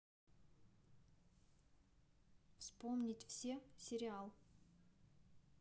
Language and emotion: Russian, neutral